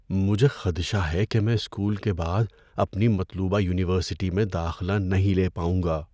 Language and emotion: Urdu, fearful